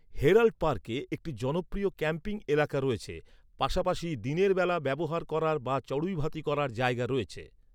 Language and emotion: Bengali, neutral